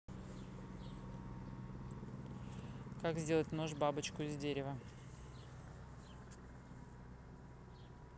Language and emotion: Russian, neutral